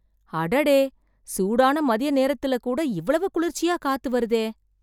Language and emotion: Tamil, surprised